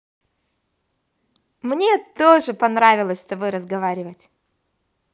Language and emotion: Russian, positive